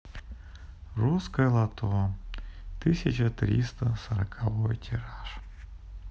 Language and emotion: Russian, sad